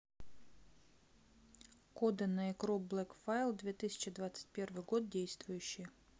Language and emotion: Russian, neutral